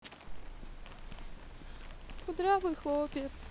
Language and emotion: Russian, sad